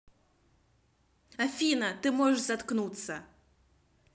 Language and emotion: Russian, angry